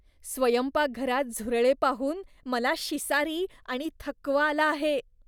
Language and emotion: Marathi, disgusted